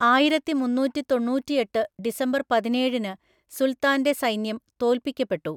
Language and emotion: Malayalam, neutral